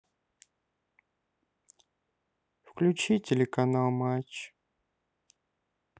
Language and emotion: Russian, sad